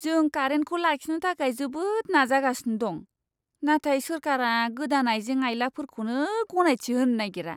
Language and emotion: Bodo, disgusted